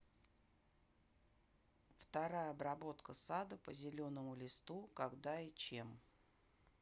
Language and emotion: Russian, neutral